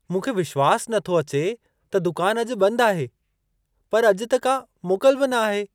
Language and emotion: Sindhi, surprised